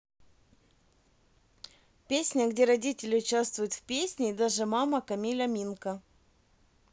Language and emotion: Russian, neutral